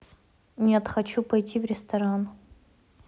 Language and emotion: Russian, neutral